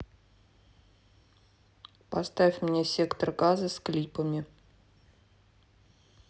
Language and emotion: Russian, neutral